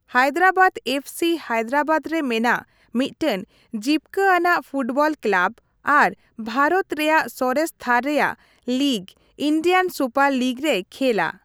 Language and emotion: Santali, neutral